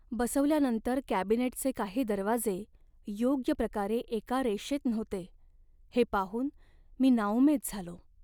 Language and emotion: Marathi, sad